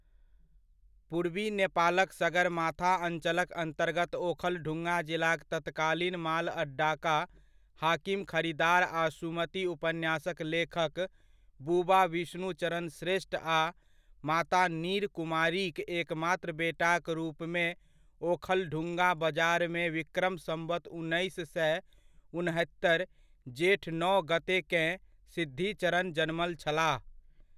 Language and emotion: Maithili, neutral